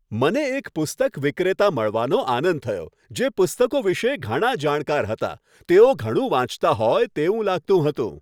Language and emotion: Gujarati, happy